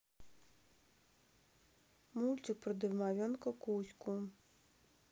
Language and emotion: Russian, neutral